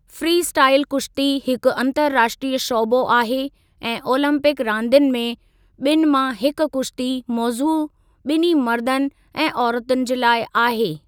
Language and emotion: Sindhi, neutral